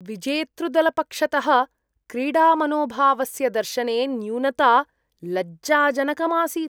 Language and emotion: Sanskrit, disgusted